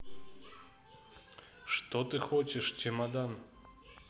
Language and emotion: Russian, neutral